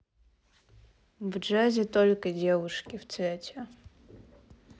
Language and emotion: Russian, neutral